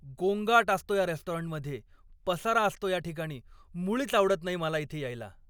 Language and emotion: Marathi, angry